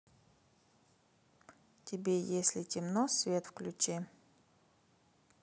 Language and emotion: Russian, neutral